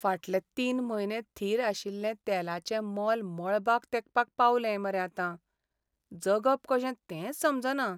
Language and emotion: Goan Konkani, sad